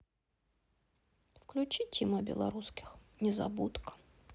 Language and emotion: Russian, sad